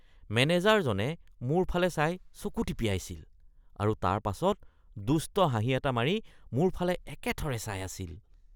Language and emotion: Assamese, disgusted